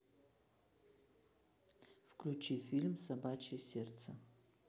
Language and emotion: Russian, neutral